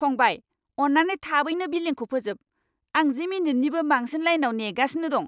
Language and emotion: Bodo, angry